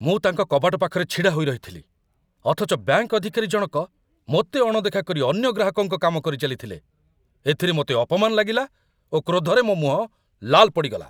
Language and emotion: Odia, angry